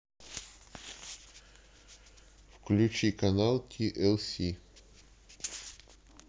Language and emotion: Russian, neutral